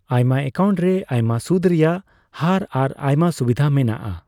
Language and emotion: Santali, neutral